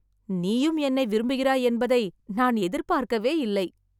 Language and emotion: Tamil, surprised